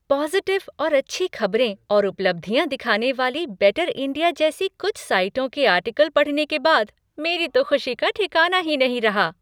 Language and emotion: Hindi, happy